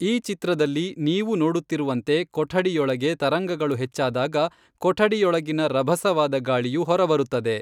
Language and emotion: Kannada, neutral